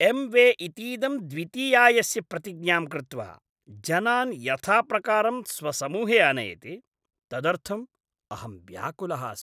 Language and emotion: Sanskrit, disgusted